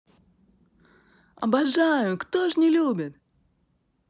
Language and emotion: Russian, positive